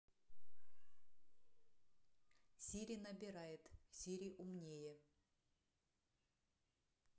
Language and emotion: Russian, neutral